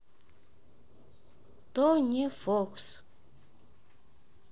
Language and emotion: Russian, neutral